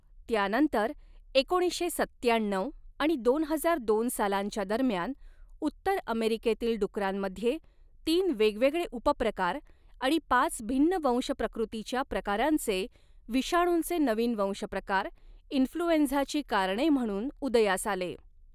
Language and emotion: Marathi, neutral